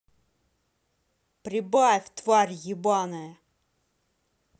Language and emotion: Russian, angry